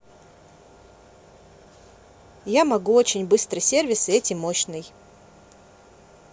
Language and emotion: Russian, positive